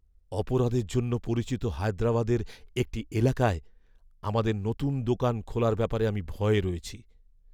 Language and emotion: Bengali, fearful